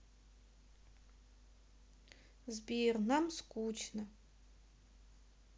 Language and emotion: Russian, sad